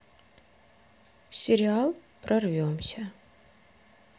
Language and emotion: Russian, neutral